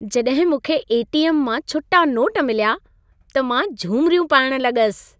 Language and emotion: Sindhi, happy